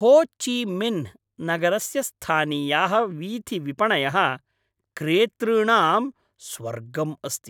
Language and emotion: Sanskrit, happy